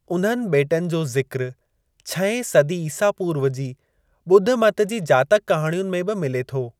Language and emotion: Sindhi, neutral